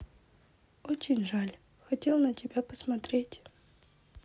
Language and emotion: Russian, sad